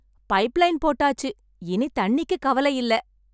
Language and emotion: Tamil, happy